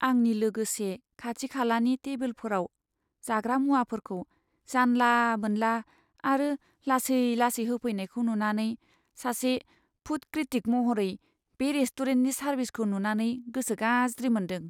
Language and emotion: Bodo, sad